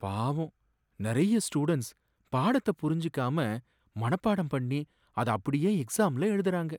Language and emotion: Tamil, sad